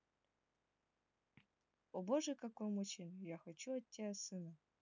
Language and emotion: Russian, neutral